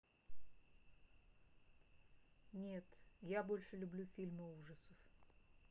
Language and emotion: Russian, neutral